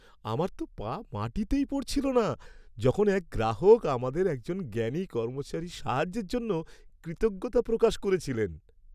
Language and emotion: Bengali, happy